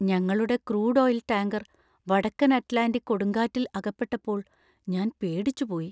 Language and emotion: Malayalam, fearful